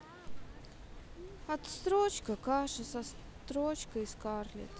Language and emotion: Russian, sad